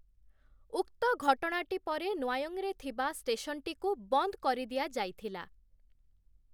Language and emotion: Odia, neutral